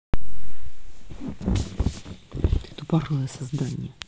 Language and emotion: Russian, angry